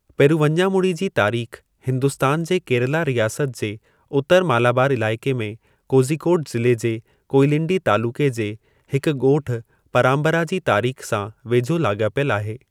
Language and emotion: Sindhi, neutral